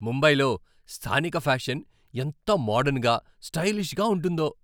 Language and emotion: Telugu, happy